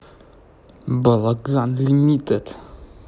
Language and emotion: Russian, angry